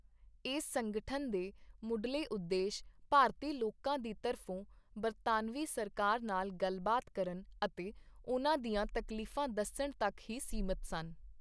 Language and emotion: Punjabi, neutral